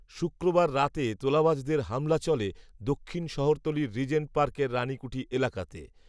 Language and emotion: Bengali, neutral